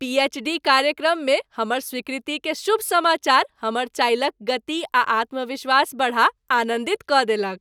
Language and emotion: Maithili, happy